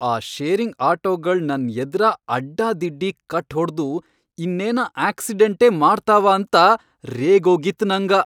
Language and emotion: Kannada, angry